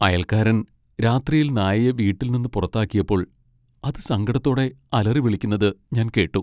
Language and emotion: Malayalam, sad